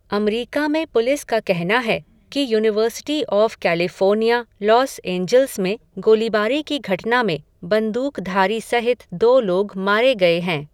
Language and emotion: Hindi, neutral